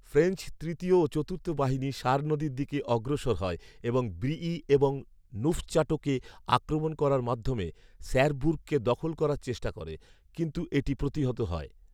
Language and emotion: Bengali, neutral